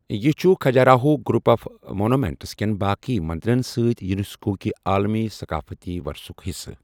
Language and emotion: Kashmiri, neutral